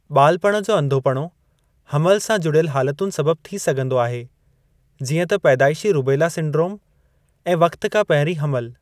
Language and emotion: Sindhi, neutral